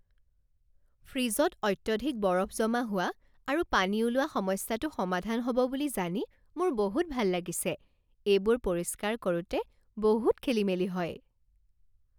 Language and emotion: Assamese, happy